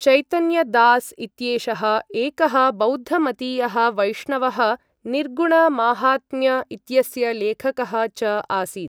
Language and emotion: Sanskrit, neutral